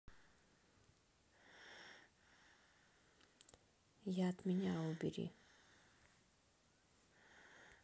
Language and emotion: Russian, sad